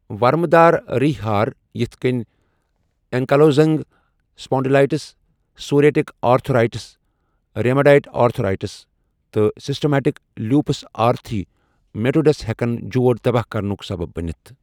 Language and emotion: Kashmiri, neutral